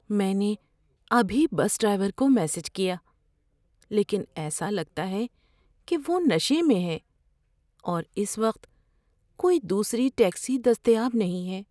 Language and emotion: Urdu, fearful